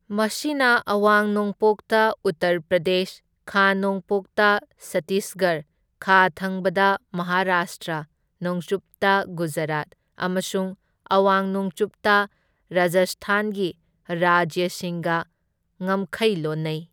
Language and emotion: Manipuri, neutral